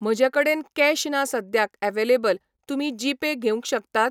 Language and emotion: Goan Konkani, neutral